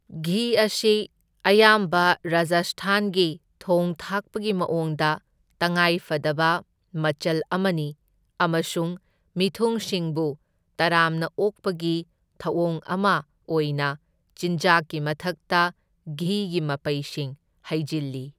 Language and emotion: Manipuri, neutral